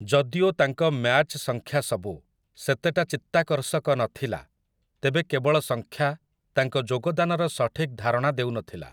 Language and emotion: Odia, neutral